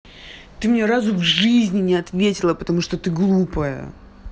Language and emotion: Russian, angry